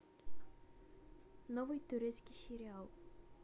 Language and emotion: Russian, neutral